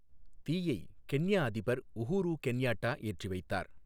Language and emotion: Tamil, neutral